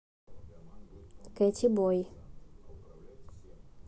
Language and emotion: Russian, neutral